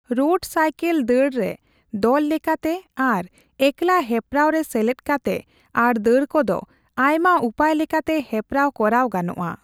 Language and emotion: Santali, neutral